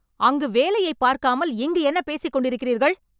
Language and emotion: Tamil, angry